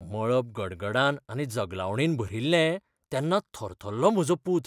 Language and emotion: Goan Konkani, fearful